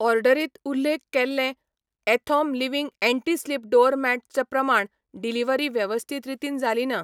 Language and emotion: Goan Konkani, neutral